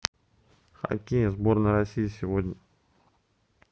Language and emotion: Russian, neutral